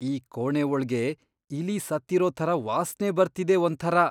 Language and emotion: Kannada, disgusted